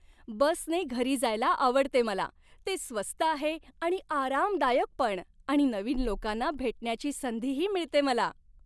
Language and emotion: Marathi, happy